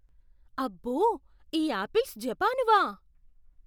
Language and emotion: Telugu, surprised